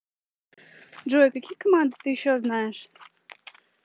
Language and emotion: Russian, neutral